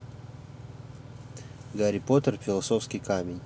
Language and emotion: Russian, neutral